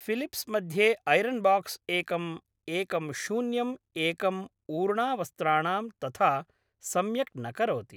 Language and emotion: Sanskrit, neutral